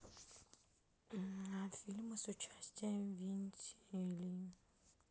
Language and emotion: Russian, sad